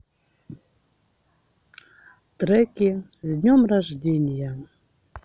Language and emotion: Russian, neutral